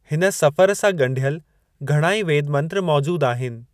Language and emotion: Sindhi, neutral